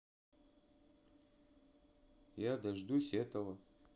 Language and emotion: Russian, neutral